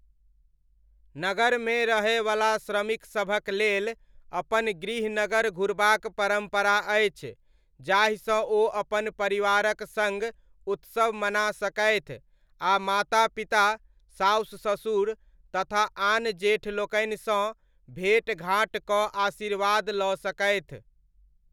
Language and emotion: Maithili, neutral